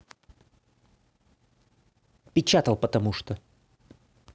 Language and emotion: Russian, angry